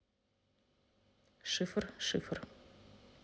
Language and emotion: Russian, neutral